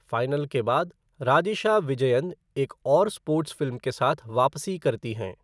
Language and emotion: Hindi, neutral